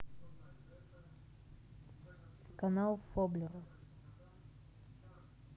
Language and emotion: Russian, neutral